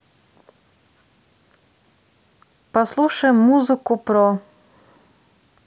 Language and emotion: Russian, neutral